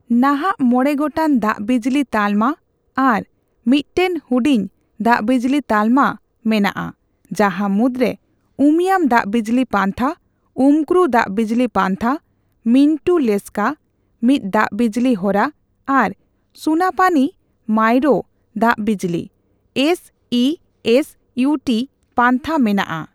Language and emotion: Santali, neutral